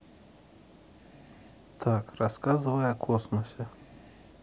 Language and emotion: Russian, neutral